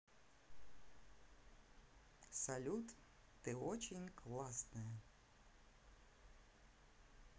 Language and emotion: Russian, positive